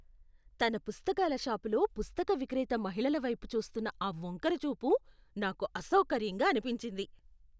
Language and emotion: Telugu, disgusted